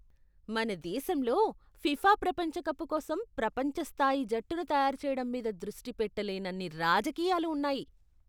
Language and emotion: Telugu, disgusted